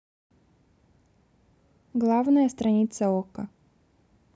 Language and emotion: Russian, neutral